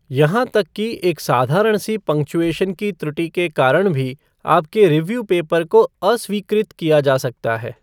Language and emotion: Hindi, neutral